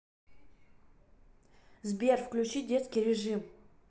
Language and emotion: Russian, neutral